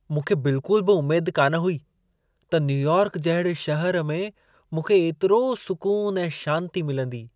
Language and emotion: Sindhi, surprised